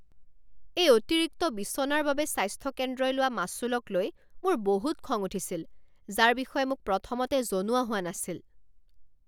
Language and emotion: Assamese, angry